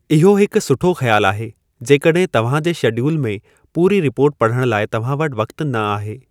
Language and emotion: Sindhi, neutral